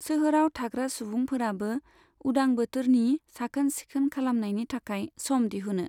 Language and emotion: Bodo, neutral